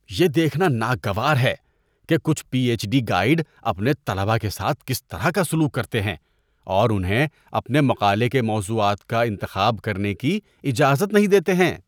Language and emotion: Urdu, disgusted